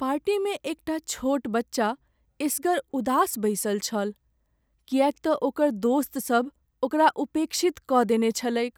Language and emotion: Maithili, sad